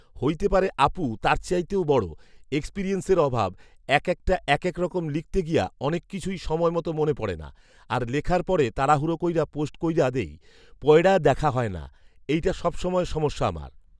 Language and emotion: Bengali, neutral